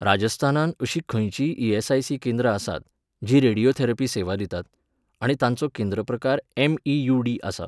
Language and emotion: Goan Konkani, neutral